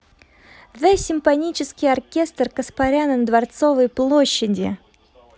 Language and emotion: Russian, positive